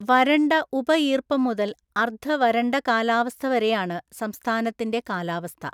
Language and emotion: Malayalam, neutral